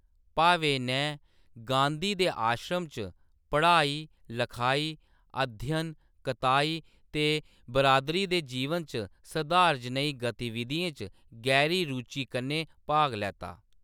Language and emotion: Dogri, neutral